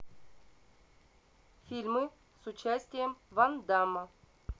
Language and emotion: Russian, neutral